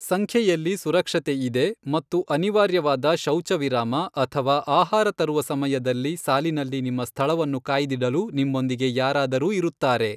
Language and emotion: Kannada, neutral